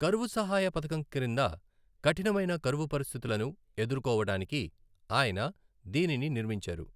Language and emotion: Telugu, neutral